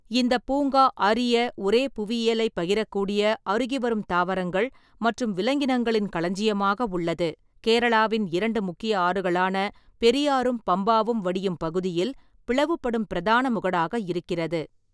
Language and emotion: Tamil, neutral